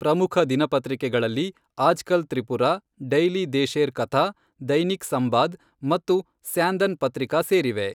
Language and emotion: Kannada, neutral